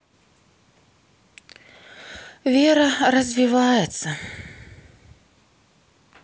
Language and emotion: Russian, sad